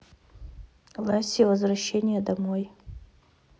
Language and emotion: Russian, neutral